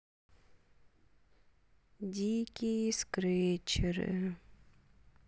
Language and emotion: Russian, neutral